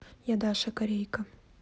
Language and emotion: Russian, neutral